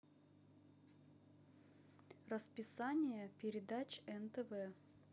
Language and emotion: Russian, neutral